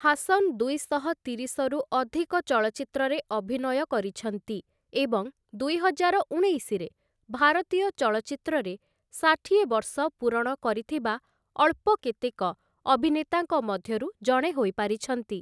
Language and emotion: Odia, neutral